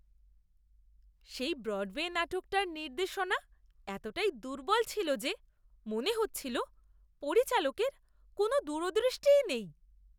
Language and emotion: Bengali, disgusted